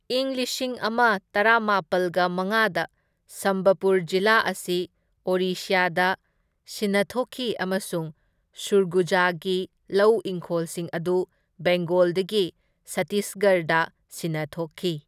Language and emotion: Manipuri, neutral